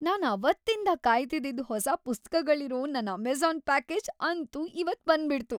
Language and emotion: Kannada, happy